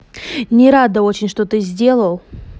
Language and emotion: Russian, angry